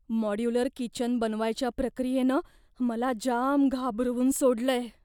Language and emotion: Marathi, fearful